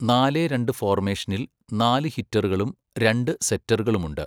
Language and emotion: Malayalam, neutral